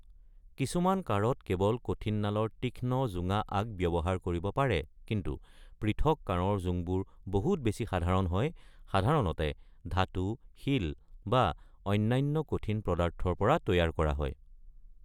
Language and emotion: Assamese, neutral